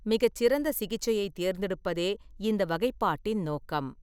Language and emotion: Tamil, neutral